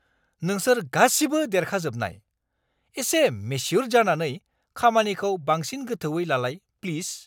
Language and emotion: Bodo, angry